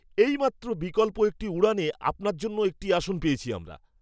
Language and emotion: Bengali, surprised